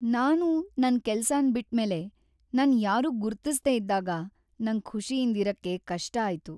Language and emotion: Kannada, sad